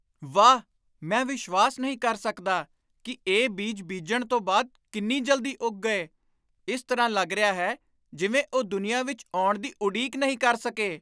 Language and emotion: Punjabi, surprised